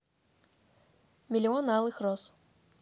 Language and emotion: Russian, neutral